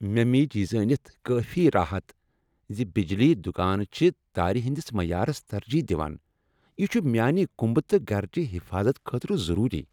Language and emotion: Kashmiri, happy